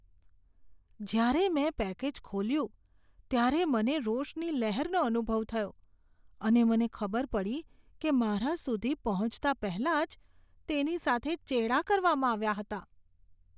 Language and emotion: Gujarati, disgusted